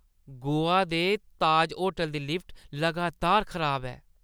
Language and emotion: Dogri, disgusted